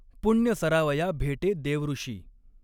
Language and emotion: Marathi, neutral